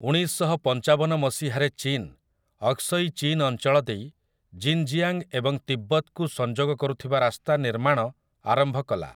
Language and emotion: Odia, neutral